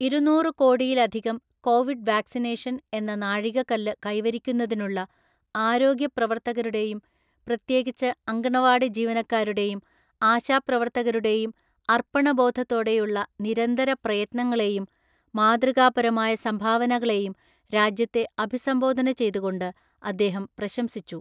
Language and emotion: Malayalam, neutral